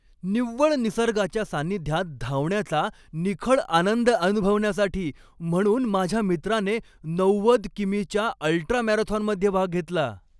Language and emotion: Marathi, happy